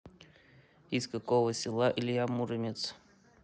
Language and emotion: Russian, neutral